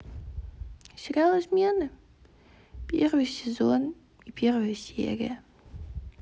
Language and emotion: Russian, sad